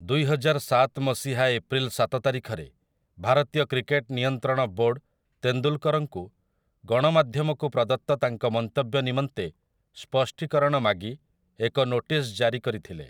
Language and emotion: Odia, neutral